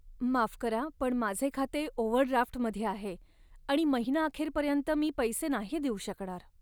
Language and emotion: Marathi, sad